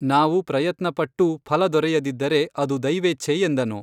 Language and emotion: Kannada, neutral